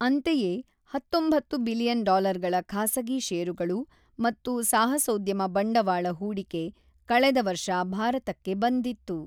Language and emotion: Kannada, neutral